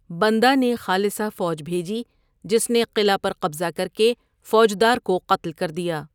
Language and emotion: Urdu, neutral